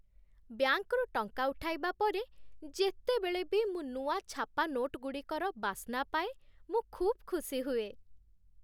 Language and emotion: Odia, happy